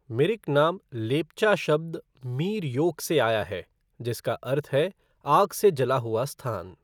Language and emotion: Hindi, neutral